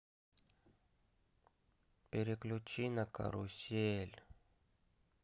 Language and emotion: Russian, sad